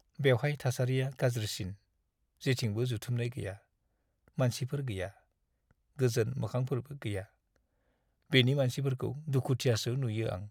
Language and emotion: Bodo, sad